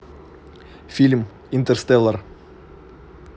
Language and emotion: Russian, neutral